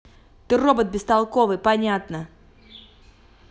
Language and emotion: Russian, angry